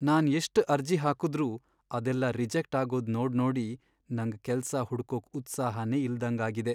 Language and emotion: Kannada, sad